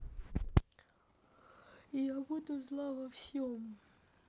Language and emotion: Russian, neutral